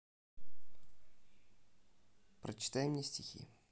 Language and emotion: Russian, neutral